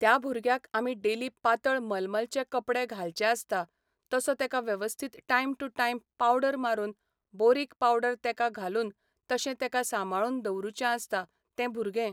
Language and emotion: Goan Konkani, neutral